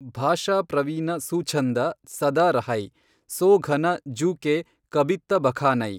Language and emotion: Kannada, neutral